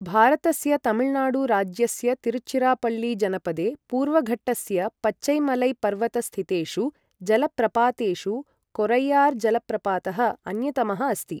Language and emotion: Sanskrit, neutral